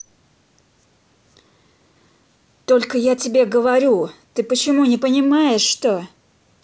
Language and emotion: Russian, angry